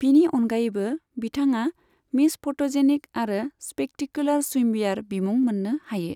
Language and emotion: Bodo, neutral